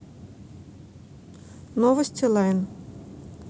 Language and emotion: Russian, neutral